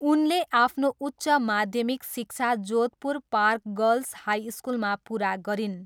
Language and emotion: Nepali, neutral